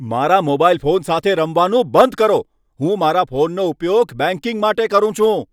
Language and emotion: Gujarati, angry